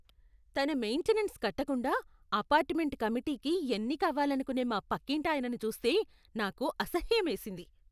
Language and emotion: Telugu, disgusted